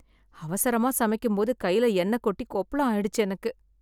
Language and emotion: Tamil, sad